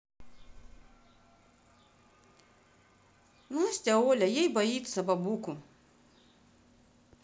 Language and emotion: Russian, neutral